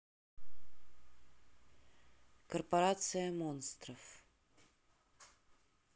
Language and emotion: Russian, neutral